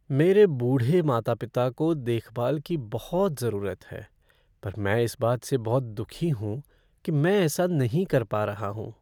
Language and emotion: Hindi, sad